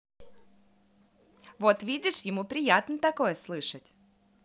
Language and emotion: Russian, positive